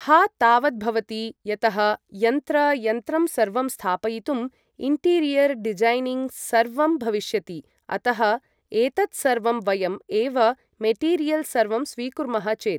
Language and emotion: Sanskrit, neutral